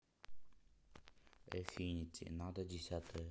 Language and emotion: Russian, neutral